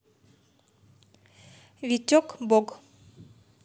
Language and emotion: Russian, neutral